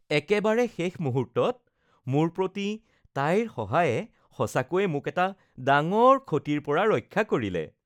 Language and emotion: Assamese, happy